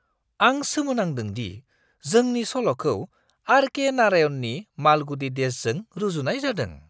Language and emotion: Bodo, surprised